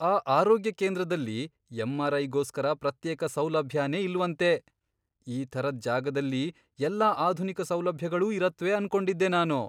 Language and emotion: Kannada, surprised